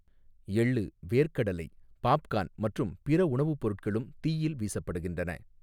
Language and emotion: Tamil, neutral